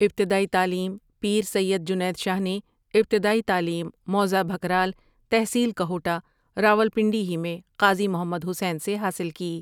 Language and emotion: Urdu, neutral